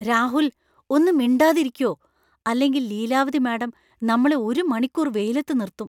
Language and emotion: Malayalam, fearful